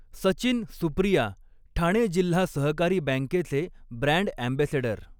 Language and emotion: Marathi, neutral